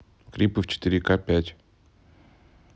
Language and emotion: Russian, neutral